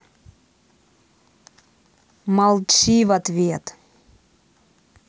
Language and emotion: Russian, angry